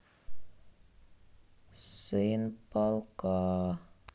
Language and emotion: Russian, sad